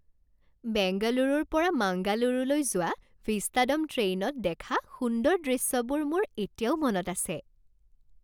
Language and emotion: Assamese, happy